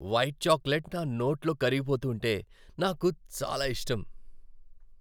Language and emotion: Telugu, happy